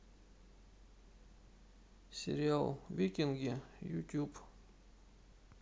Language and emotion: Russian, sad